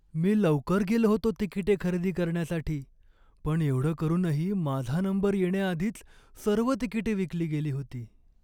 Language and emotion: Marathi, sad